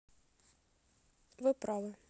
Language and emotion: Russian, neutral